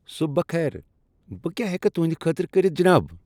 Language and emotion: Kashmiri, happy